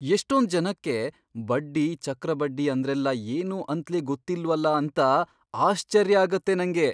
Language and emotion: Kannada, surprised